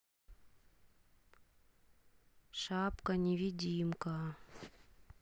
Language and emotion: Russian, neutral